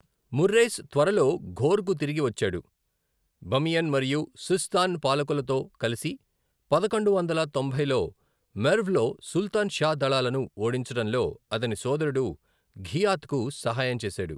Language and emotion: Telugu, neutral